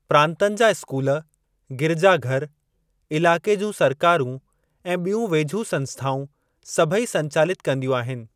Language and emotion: Sindhi, neutral